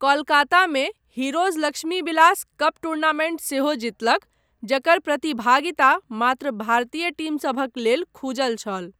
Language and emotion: Maithili, neutral